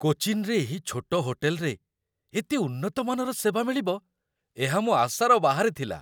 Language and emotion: Odia, surprised